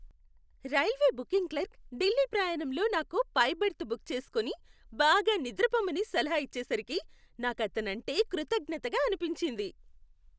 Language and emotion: Telugu, happy